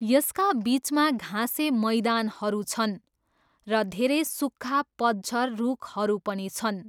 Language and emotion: Nepali, neutral